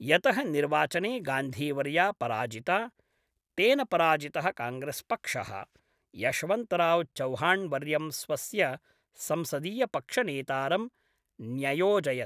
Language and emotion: Sanskrit, neutral